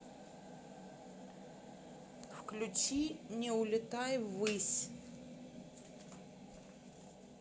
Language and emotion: Russian, neutral